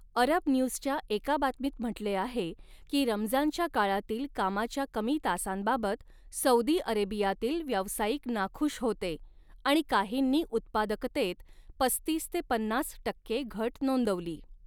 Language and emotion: Marathi, neutral